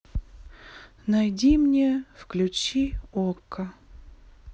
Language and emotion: Russian, sad